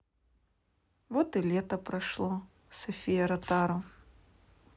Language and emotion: Russian, sad